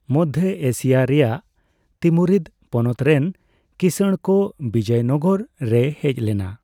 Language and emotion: Santali, neutral